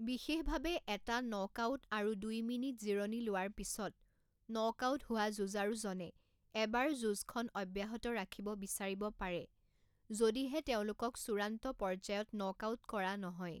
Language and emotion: Assamese, neutral